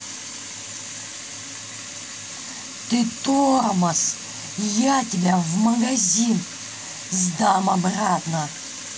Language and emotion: Russian, angry